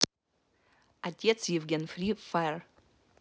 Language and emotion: Russian, neutral